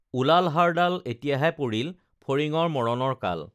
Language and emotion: Assamese, neutral